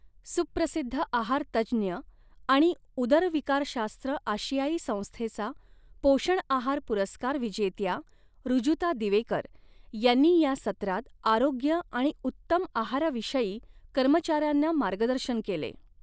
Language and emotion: Marathi, neutral